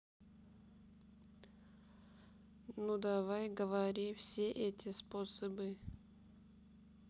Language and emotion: Russian, neutral